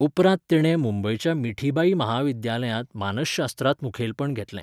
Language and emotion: Goan Konkani, neutral